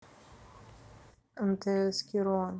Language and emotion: Russian, neutral